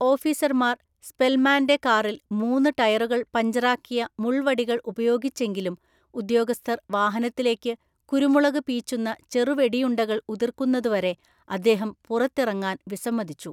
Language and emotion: Malayalam, neutral